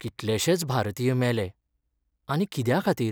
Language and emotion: Goan Konkani, sad